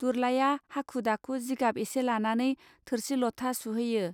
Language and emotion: Bodo, neutral